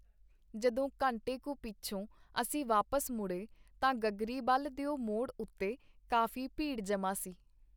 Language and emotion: Punjabi, neutral